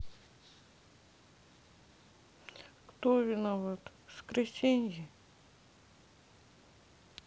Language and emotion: Russian, sad